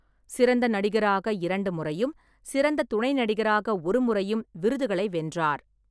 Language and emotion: Tamil, neutral